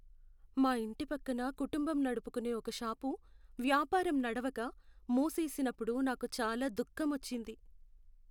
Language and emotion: Telugu, sad